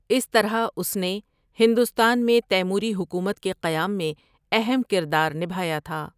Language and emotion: Urdu, neutral